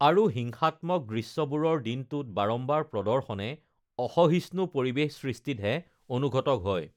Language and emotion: Assamese, neutral